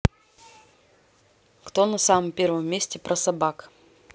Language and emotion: Russian, neutral